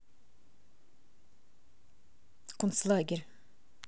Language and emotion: Russian, neutral